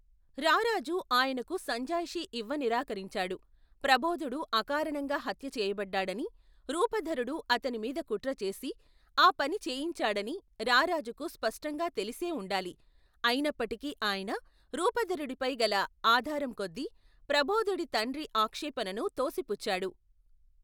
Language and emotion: Telugu, neutral